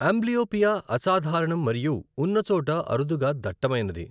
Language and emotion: Telugu, neutral